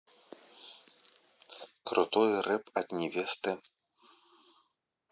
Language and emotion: Russian, neutral